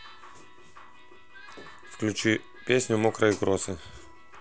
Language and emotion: Russian, neutral